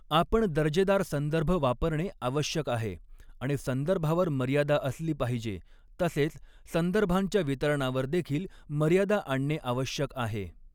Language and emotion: Marathi, neutral